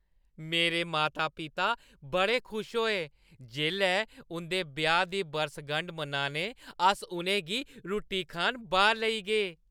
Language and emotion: Dogri, happy